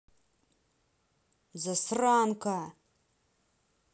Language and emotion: Russian, angry